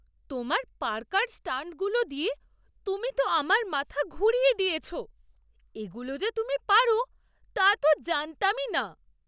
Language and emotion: Bengali, surprised